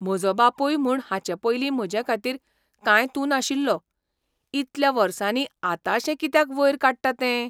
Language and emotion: Goan Konkani, surprised